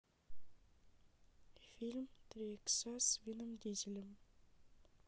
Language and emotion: Russian, sad